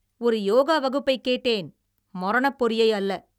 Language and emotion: Tamil, angry